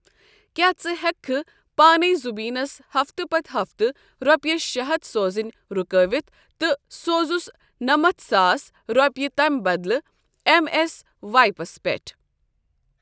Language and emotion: Kashmiri, neutral